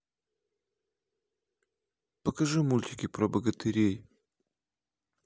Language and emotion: Russian, neutral